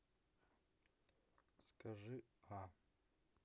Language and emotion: Russian, neutral